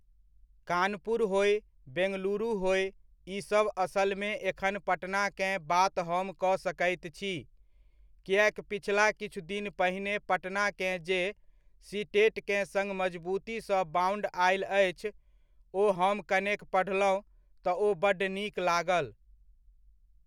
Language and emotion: Maithili, neutral